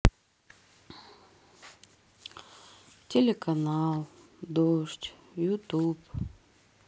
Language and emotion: Russian, sad